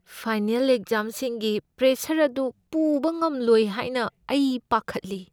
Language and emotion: Manipuri, fearful